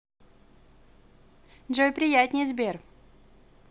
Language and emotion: Russian, positive